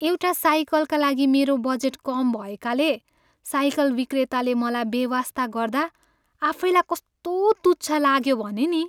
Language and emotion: Nepali, sad